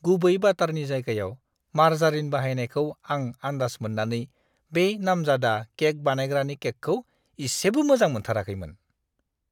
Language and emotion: Bodo, disgusted